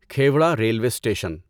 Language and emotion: Urdu, neutral